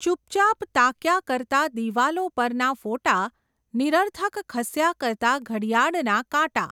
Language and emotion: Gujarati, neutral